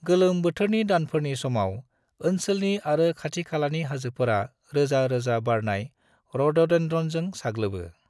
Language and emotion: Bodo, neutral